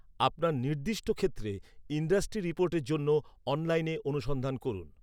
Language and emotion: Bengali, neutral